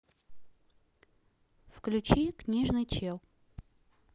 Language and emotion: Russian, neutral